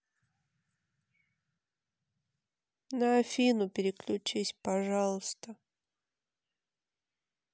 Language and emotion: Russian, sad